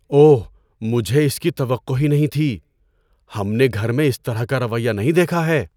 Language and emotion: Urdu, surprised